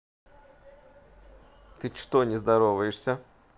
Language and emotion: Russian, neutral